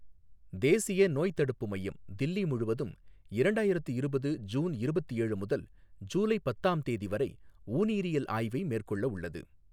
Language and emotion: Tamil, neutral